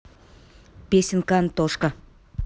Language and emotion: Russian, neutral